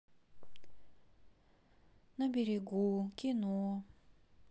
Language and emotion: Russian, sad